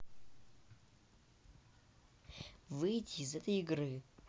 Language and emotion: Russian, neutral